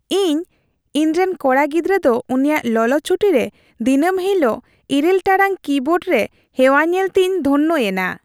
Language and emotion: Santali, happy